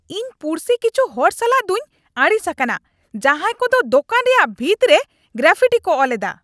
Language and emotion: Santali, angry